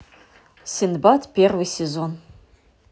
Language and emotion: Russian, neutral